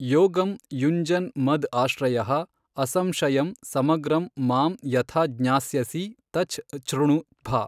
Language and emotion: Kannada, neutral